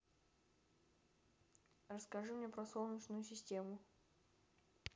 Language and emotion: Russian, neutral